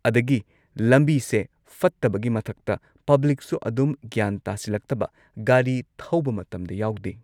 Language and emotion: Manipuri, neutral